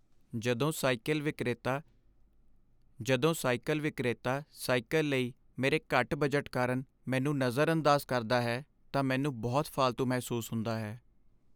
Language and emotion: Punjabi, sad